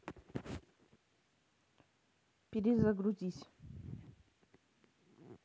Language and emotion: Russian, neutral